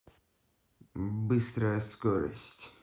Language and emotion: Russian, neutral